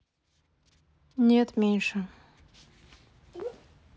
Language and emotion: Russian, sad